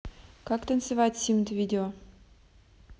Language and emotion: Russian, neutral